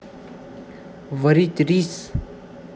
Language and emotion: Russian, neutral